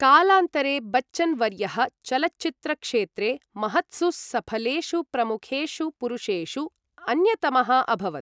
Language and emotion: Sanskrit, neutral